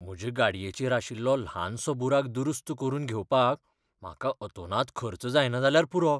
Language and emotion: Goan Konkani, fearful